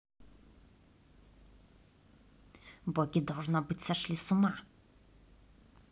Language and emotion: Russian, neutral